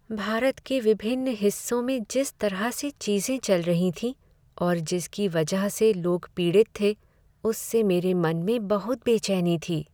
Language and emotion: Hindi, sad